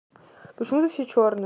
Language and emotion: Russian, neutral